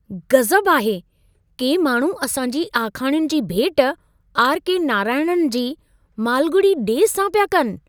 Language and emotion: Sindhi, surprised